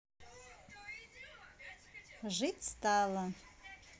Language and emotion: Russian, positive